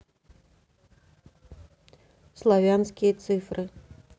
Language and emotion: Russian, neutral